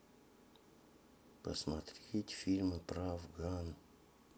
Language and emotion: Russian, sad